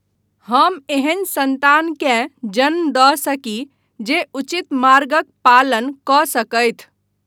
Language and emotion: Maithili, neutral